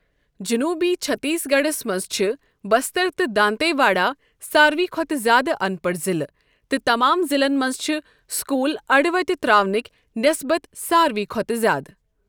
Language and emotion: Kashmiri, neutral